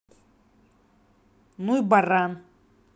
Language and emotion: Russian, angry